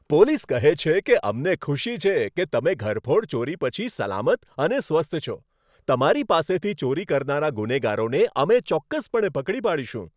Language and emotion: Gujarati, happy